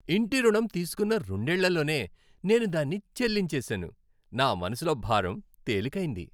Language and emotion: Telugu, happy